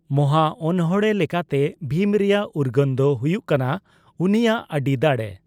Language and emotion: Santali, neutral